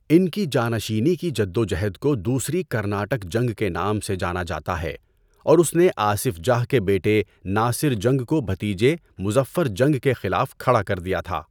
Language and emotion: Urdu, neutral